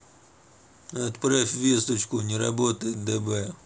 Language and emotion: Russian, neutral